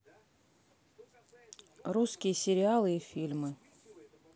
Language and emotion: Russian, neutral